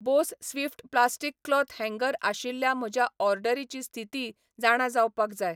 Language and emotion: Goan Konkani, neutral